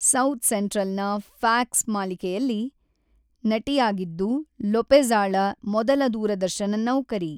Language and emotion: Kannada, neutral